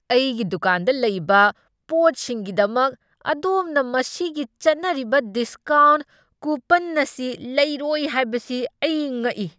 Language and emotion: Manipuri, angry